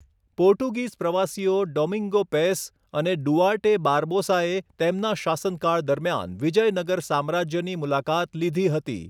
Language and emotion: Gujarati, neutral